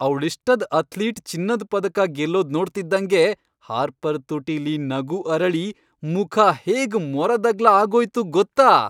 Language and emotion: Kannada, happy